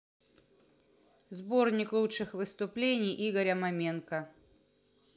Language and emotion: Russian, neutral